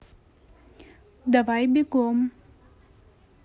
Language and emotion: Russian, neutral